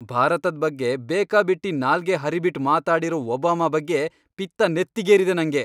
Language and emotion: Kannada, angry